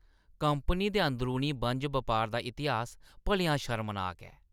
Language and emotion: Dogri, disgusted